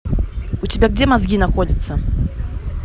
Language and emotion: Russian, angry